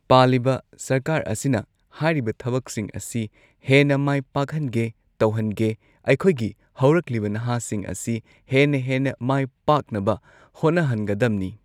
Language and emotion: Manipuri, neutral